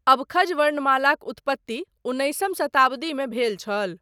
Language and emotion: Maithili, neutral